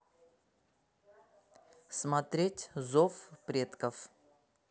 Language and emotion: Russian, neutral